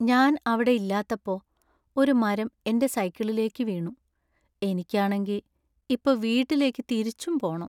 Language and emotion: Malayalam, sad